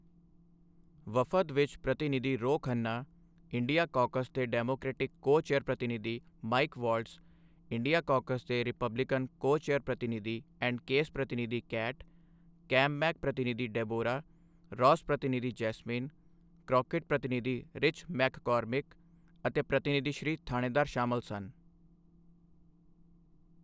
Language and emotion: Punjabi, neutral